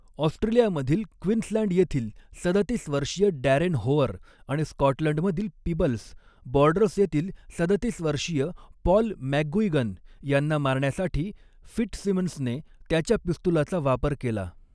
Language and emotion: Marathi, neutral